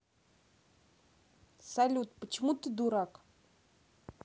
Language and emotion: Russian, neutral